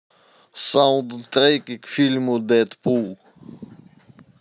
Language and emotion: Russian, neutral